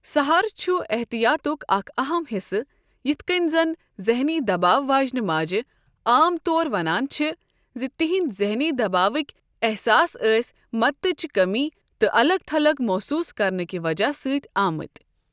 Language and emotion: Kashmiri, neutral